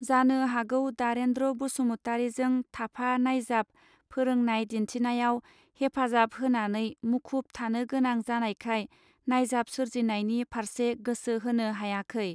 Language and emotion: Bodo, neutral